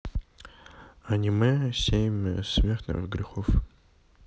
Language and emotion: Russian, neutral